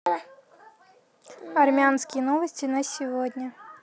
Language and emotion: Russian, neutral